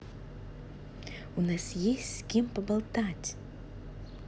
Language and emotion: Russian, positive